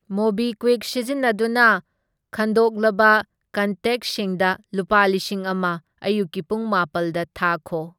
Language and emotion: Manipuri, neutral